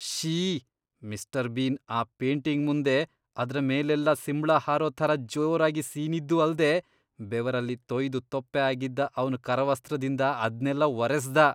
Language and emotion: Kannada, disgusted